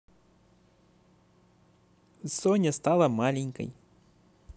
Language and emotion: Russian, positive